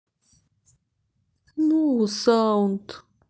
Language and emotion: Russian, sad